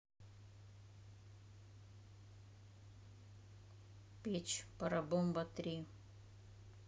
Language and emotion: Russian, neutral